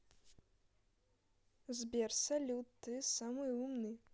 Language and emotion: Russian, neutral